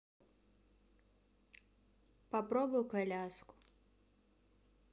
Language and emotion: Russian, sad